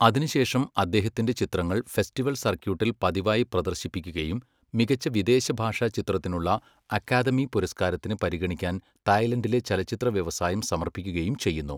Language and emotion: Malayalam, neutral